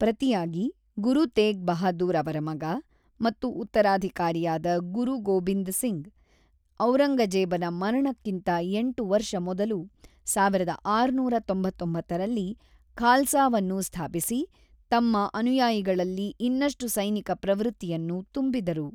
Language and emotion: Kannada, neutral